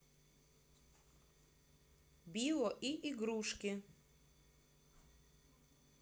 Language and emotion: Russian, neutral